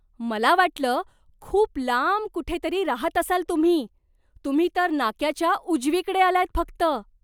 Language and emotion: Marathi, surprised